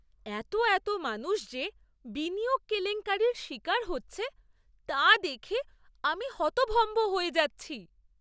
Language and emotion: Bengali, surprised